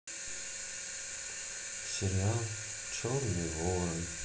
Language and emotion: Russian, sad